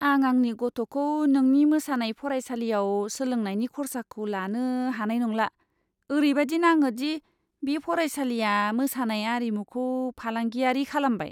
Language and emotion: Bodo, disgusted